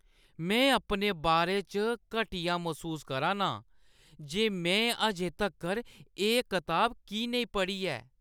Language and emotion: Dogri, disgusted